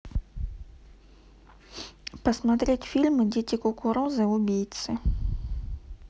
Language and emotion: Russian, neutral